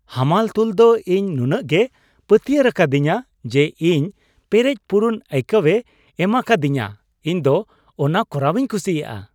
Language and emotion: Santali, happy